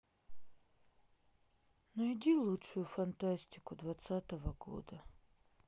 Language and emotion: Russian, sad